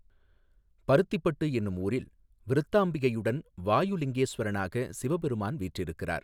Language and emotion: Tamil, neutral